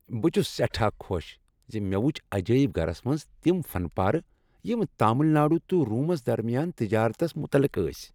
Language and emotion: Kashmiri, happy